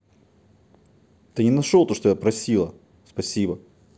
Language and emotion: Russian, angry